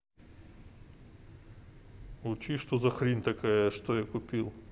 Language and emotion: Russian, angry